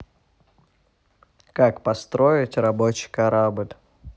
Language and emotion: Russian, neutral